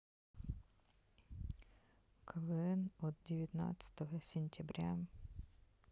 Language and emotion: Russian, neutral